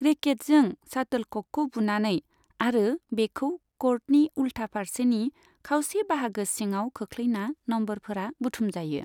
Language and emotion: Bodo, neutral